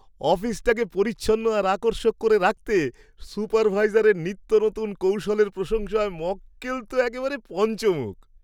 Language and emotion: Bengali, happy